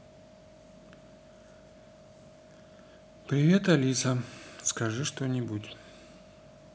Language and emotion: Russian, sad